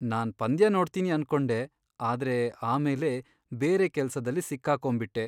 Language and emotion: Kannada, sad